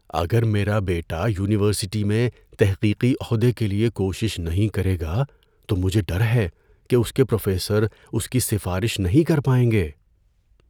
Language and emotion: Urdu, fearful